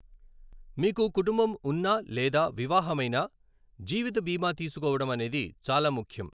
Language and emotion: Telugu, neutral